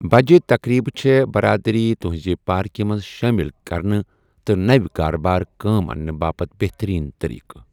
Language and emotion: Kashmiri, neutral